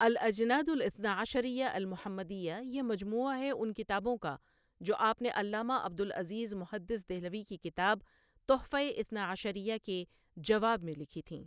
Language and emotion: Urdu, neutral